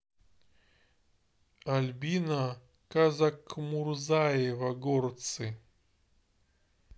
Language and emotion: Russian, neutral